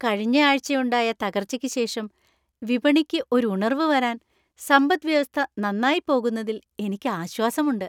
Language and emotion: Malayalam, happy